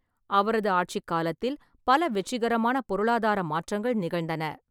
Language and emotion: Tamil, neutral